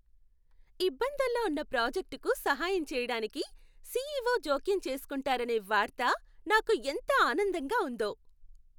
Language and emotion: Telugu, happy